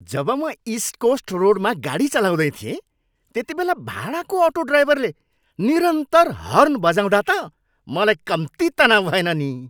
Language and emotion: Nepali, angry